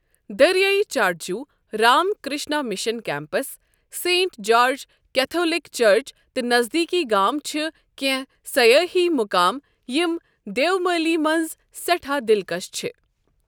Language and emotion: Kashmiri, neutral